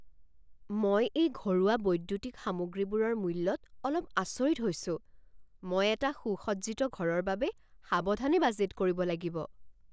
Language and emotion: Assamese, surprised